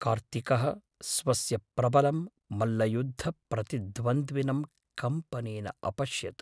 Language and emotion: Sanskrit, fearful